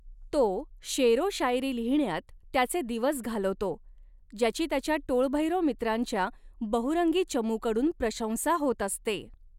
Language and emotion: Marathi, neutral